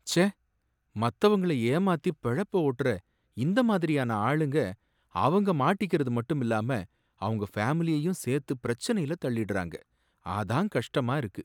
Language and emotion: Tamil, sad